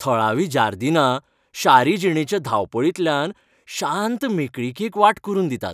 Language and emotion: Goan Konkani, happy